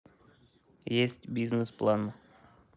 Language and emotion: Russian, neutral